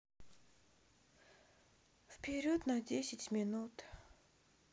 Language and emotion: Russian, sad